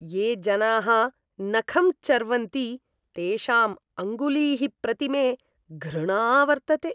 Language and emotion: Sanskrit, disgusted